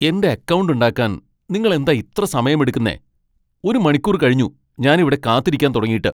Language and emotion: Malayalam, angry